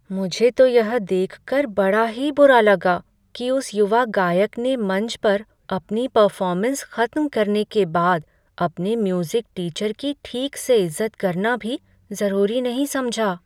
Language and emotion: Hindi, sad